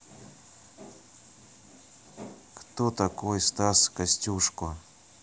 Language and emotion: Russian, neutral